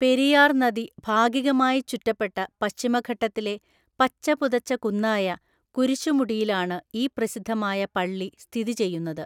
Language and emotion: Malayalam, neutral